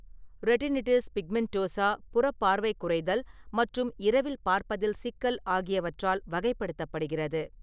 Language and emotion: Tamil, neutral